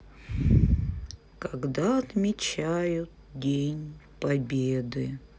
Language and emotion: Russian, sad